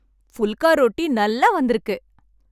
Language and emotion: Tamil, happy